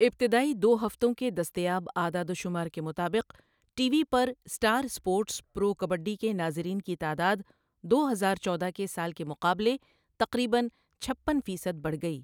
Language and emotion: Urdu, neutral